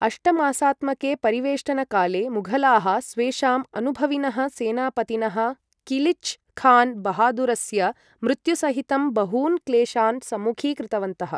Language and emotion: Sanskrit, neutral